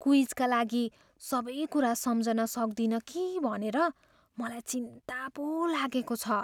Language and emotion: Nepali, fearful